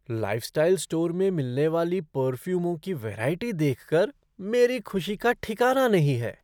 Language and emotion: Hindi, surprised